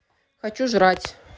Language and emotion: Russian, neutral